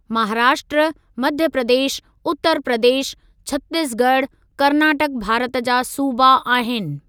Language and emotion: Sindhi, neutral